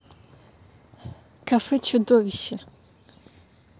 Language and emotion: Russian, neutral